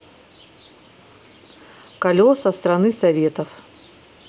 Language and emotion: Russian, neutral